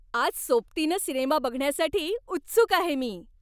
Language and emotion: Marathi, happy